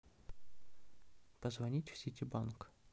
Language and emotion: Russian, neutral